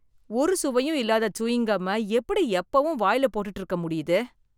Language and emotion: Tamil, disgusted